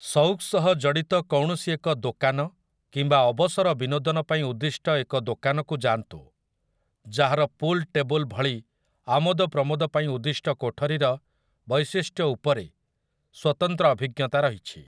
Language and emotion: Odia, neutral